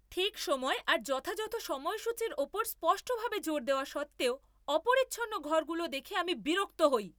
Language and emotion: Bengali, angry